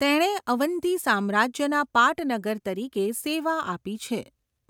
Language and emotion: Gujarati, neutral